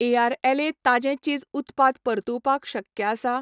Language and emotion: Goan Konkani, neutral